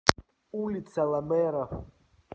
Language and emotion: Russian, neutral